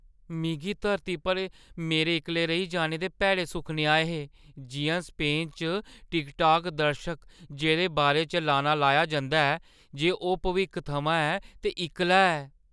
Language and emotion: Dogri, fearful